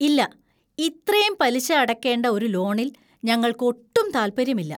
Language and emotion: Malayalam, disgusted